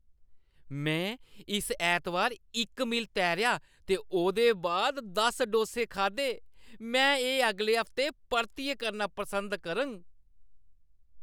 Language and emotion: Dogri, happy